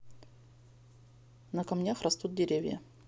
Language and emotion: Russian, neutral